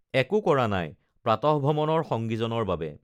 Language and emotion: Assamese, neutral